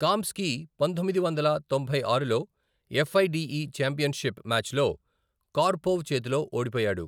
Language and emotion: Telugu, neutral